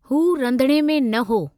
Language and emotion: Sindhi, neutral